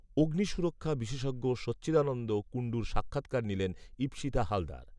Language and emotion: Bengali, neutral